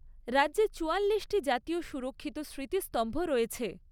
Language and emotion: Bengali, neutral